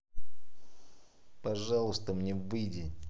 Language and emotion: Russian, angry